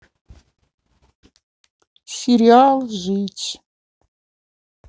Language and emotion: Russian, neutral